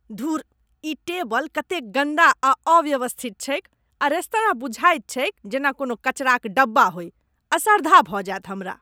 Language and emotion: Maithili, disgusted